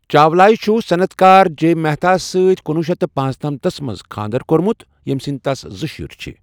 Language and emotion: Kashmiri, neutral